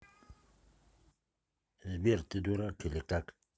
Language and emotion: Russian, neutral